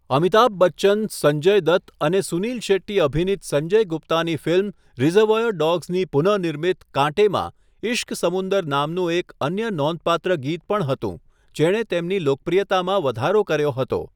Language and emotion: Gujarati, neutral